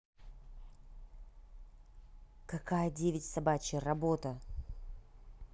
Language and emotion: Russian, neutral